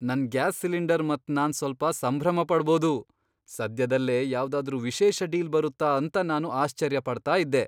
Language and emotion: Kannada, surprised